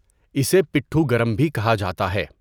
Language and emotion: Urdu, neutral